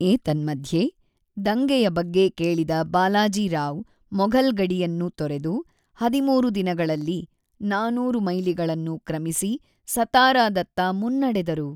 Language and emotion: Kannada, neutral